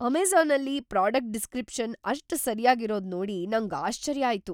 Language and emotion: Kannada, surprised